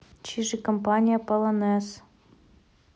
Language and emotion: Russian, neutral